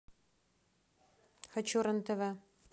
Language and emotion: Russian, neutral